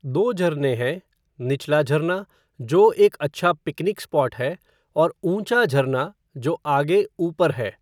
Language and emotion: Hindi, neutral